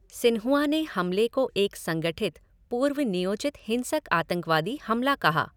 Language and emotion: Hindi, neutral